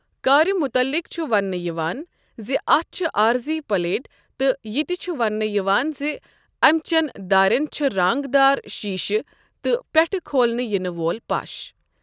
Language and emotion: Kashmiri, neutral